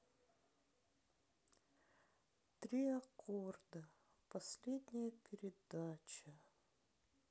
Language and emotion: Russian, sad